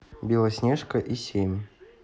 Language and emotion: Russian, neutral